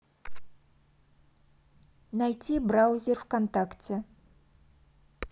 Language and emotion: Russian, neutral